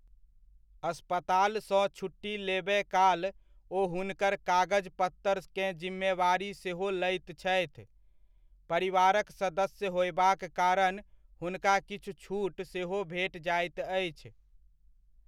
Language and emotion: Maithili, neutral